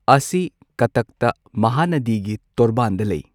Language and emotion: Manipuri, neutral